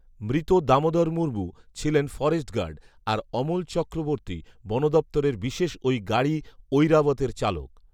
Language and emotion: Bengali, neutral